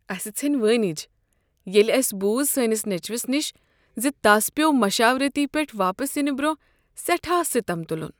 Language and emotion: Kashmiri, sad